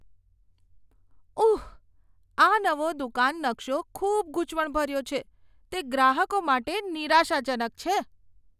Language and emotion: Gujarati, disgusted